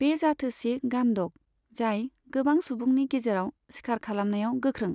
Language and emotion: Bodo, neutral